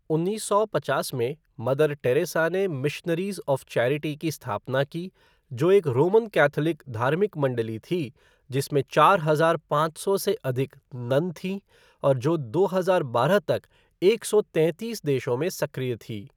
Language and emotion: Hindi, neutral